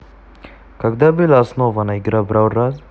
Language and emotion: Russian, neutral